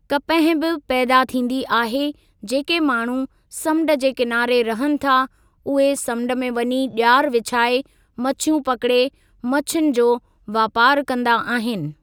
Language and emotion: Sindhi, neutral